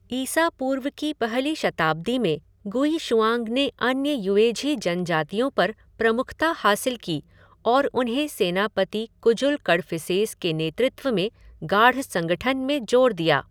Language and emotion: Hindi, neutral